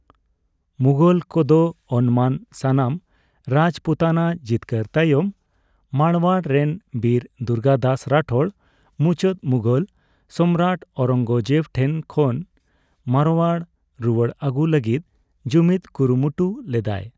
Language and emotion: Santali, neutral